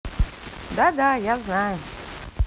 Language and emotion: Russian, positive